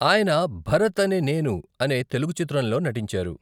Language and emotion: Telugu, neutral